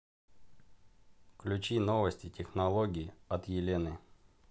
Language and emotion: Russian, neutral